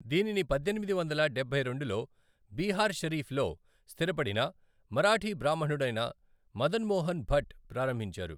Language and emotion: Telugu, neutral